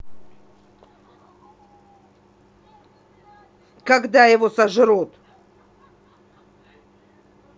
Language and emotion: Russian, angry